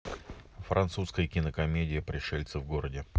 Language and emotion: Russian, neutral